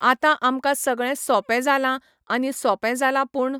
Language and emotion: Goan Konkani, neutral